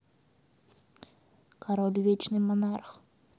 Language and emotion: Russian, neutral